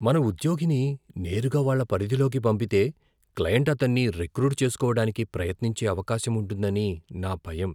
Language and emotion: Telugu, fearful